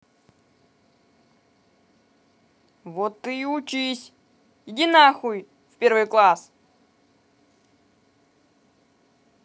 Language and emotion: Russian, angry